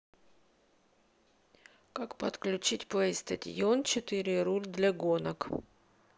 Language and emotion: Russian, neutral